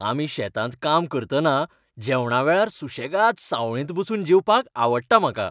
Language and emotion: Goan Konkani, happy